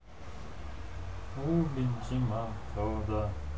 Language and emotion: Russian, neutral